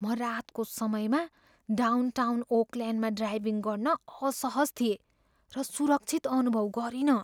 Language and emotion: Nepali, fearful